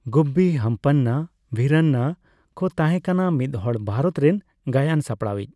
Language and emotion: Santali, neutral